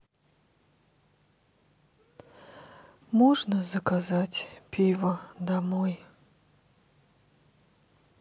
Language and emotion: Russian, sad